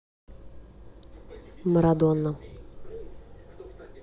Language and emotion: Russian, neutral